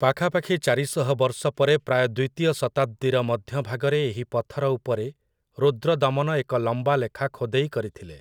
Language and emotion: Odia, neutral